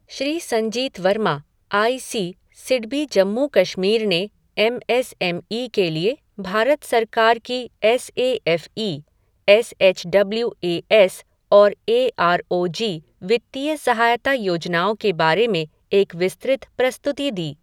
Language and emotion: Hindi, neutral